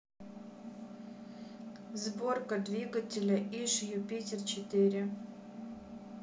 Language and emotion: Russian, neutral